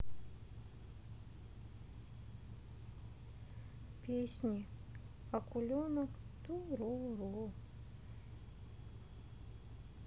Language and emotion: Russian, sad